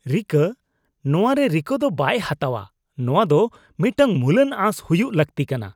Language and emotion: Santali, disgusted